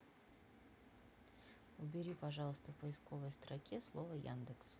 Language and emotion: Russian, neutral